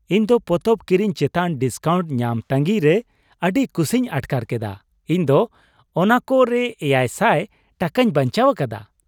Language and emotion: Santali, happy